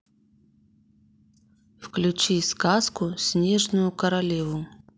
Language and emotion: Russian, neutral